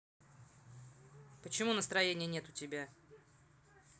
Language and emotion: Russian, angry